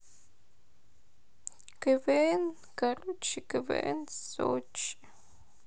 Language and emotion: Russian, sad